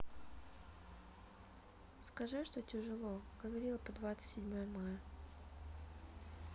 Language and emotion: Russian, sad